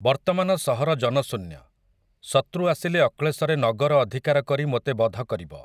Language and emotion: Odia, neutral